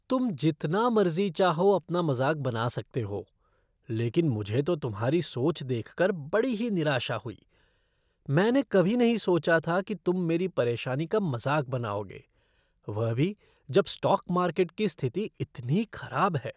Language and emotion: Hindi, disgusted